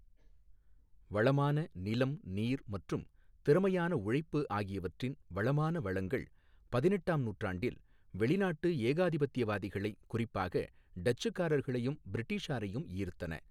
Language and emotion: Tamil, neutral